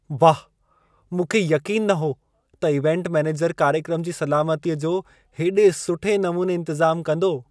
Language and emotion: Sindhi, surprised